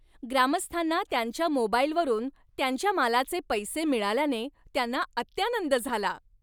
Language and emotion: Marathi, happy